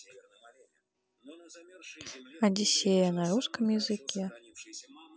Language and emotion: Russian, neutral